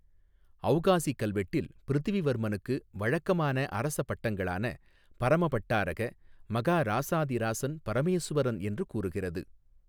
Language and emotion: Tamil, neutral